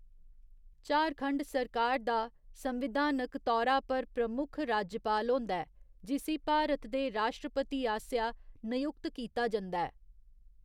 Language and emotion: Dogri, neutral